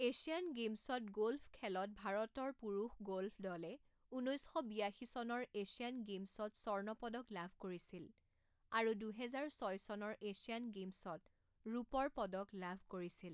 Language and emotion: Assamese, neutral